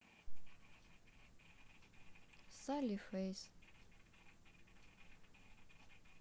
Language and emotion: Russian, sad